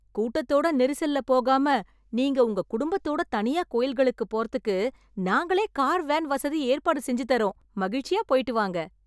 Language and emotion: Tamil, happy